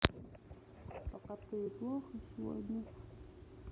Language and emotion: Russian, sad